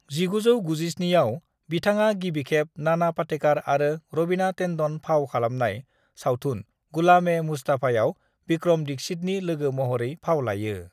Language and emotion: Bodo, neutral